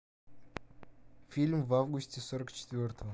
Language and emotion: Russian, neutral